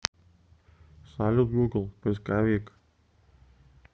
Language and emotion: Russian, neutral